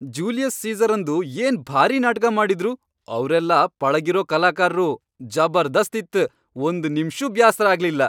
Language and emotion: Kannada, happy